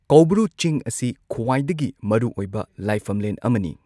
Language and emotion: Manipuri, neutral